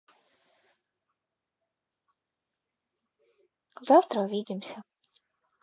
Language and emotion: Russian, neutral